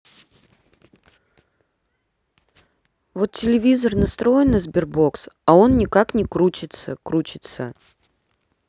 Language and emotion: Russian, neutral